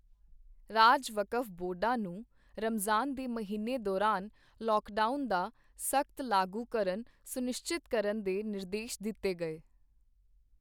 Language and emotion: Punjabi, neutral